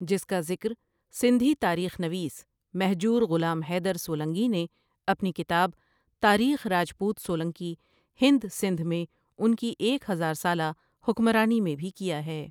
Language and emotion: Urdu, neutral